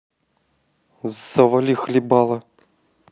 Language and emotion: Russian, angry